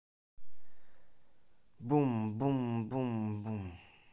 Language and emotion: Russian, positive